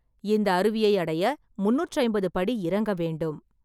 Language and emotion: Tamil, neutral